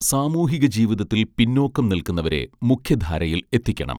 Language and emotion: Malayalam, neutral